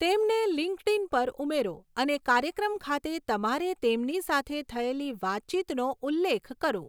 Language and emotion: Gujarati, neutral